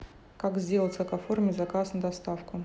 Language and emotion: Russian, neutral